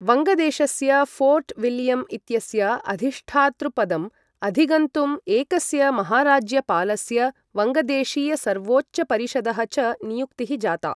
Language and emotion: Sanskrit, neutral